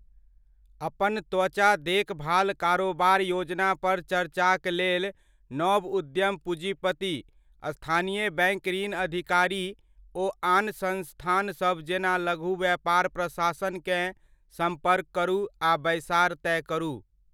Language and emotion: Maithili, neutral